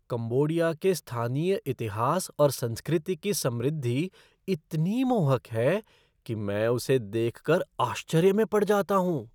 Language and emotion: Hindi, surprised